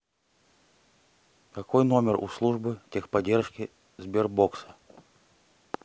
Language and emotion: Russian, neutral